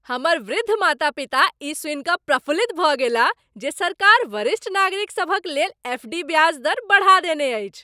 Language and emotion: Maithili, happy